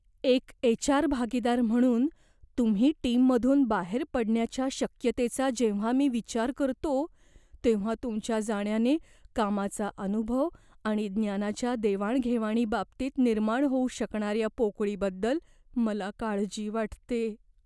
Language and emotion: Marathi, fearful